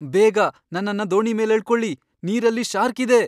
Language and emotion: Kannada, fearful